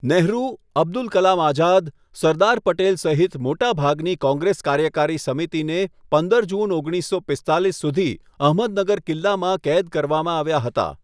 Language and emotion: Gujarati, neutral